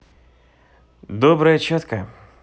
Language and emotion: Russian, positive